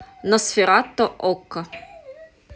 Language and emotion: Russian, neutral